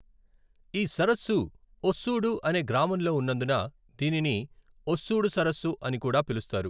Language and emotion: Telugu, neutral